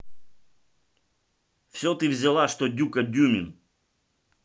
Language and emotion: Russian, angry